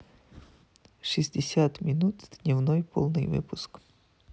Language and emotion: Russian, neutral